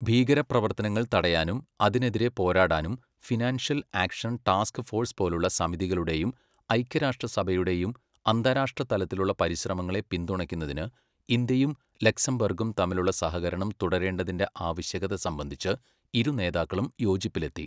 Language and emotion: Malayalam, neutral